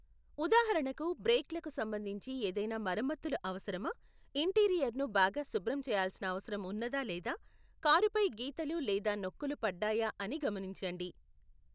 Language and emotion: Telugu, neutral